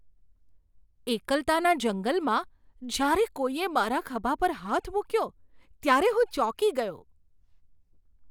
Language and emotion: Gujarati, surprised